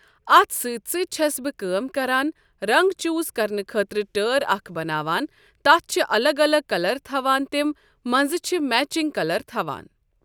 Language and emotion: Kashmiri, neutral